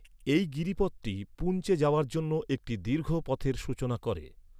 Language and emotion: Bengali, neutral